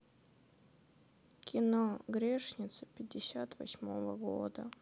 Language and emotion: Russian, sad